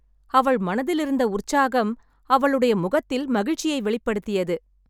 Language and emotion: Tamil, happy